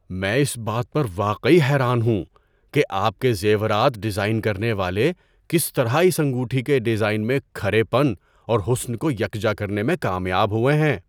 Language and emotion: Urdu, surprised